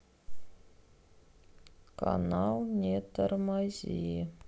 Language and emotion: Russian, sad